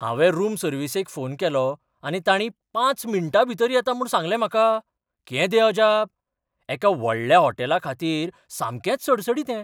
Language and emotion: Goan Konkani, surprised